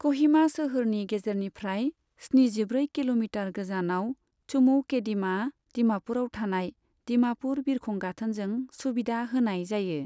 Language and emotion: Bodo, neutral